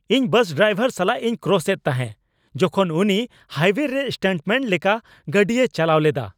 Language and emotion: Santali, angry